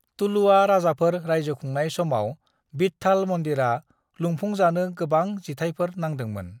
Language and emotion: Bodo, neutral